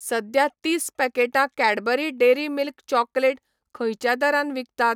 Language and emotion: Goan Konkani, neutral